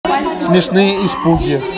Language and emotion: Russian, positive